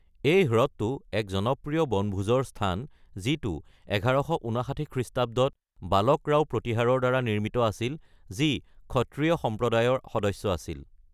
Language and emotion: Assamese, neutral